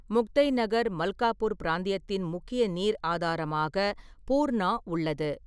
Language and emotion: Tamil, neutral